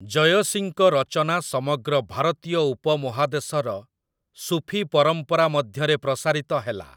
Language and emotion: Odia, neutral